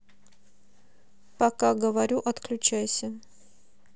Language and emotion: Russian, neutral